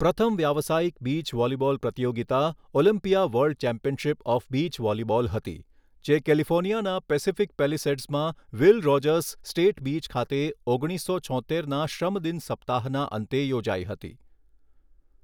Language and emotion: Gujarati, neutral